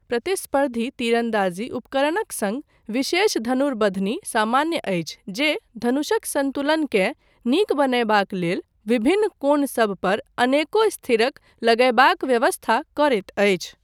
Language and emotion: Maithili, neutral